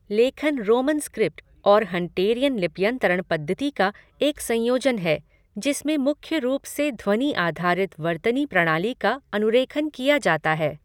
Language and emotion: Hindi, neutral